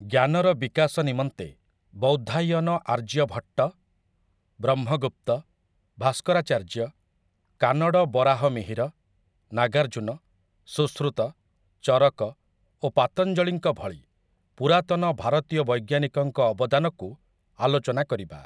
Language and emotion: Odia, neutral